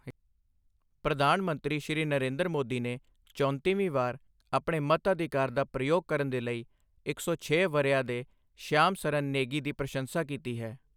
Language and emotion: Punjabi, neutral